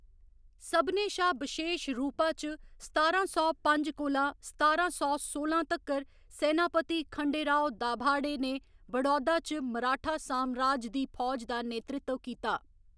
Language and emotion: Dogri, neutral